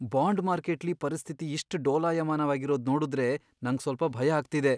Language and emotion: Kannada, fearful